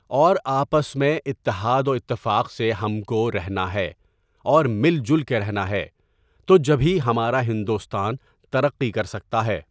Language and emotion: Urdu, neutral